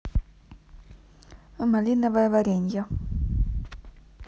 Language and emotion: Russian, neutral